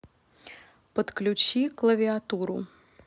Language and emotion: Russian, neutral